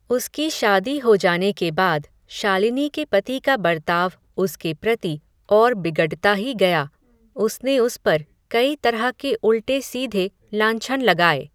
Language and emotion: Hindi, neutral